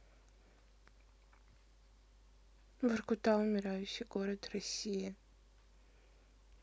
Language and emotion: Russian, sad